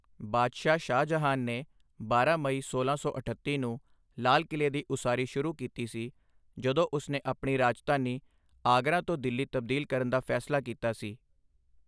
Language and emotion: Punjabi, neutral